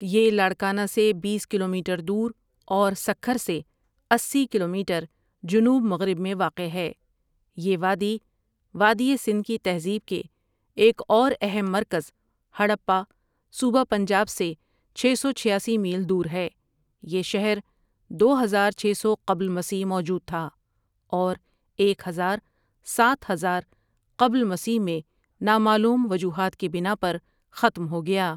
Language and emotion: Urdu, neutral